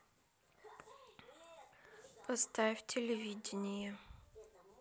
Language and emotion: Russian, neutral